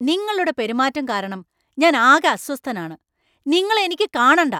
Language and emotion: Malayalam, angry